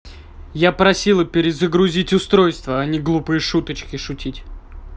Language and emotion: Russian, angry